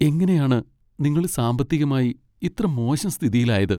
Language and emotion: Malayalam, sad